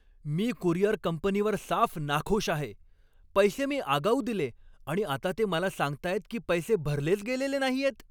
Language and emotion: Marathi, angry